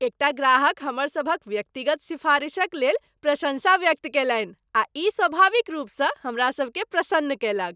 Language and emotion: Maithili, happy